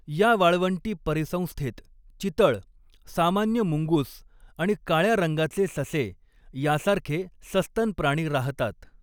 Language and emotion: Marathi, neutral